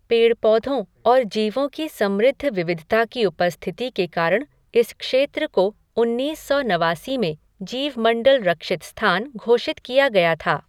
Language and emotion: Hindi, neutral